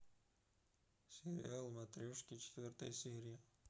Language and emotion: Russian, neutral